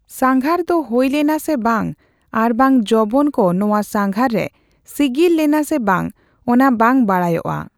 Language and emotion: Santali, neutral